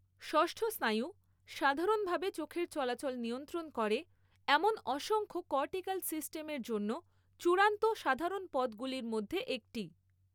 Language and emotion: Bengali, neutral